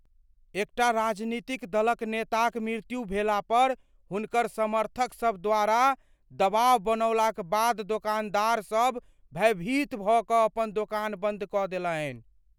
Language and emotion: Maithili, fearful